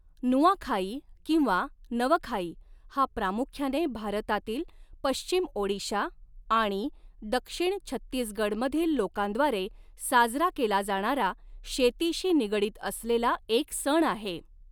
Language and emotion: Marathi, neutral